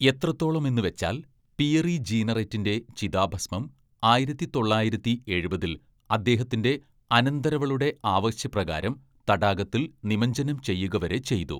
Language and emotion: Malayalam, neutral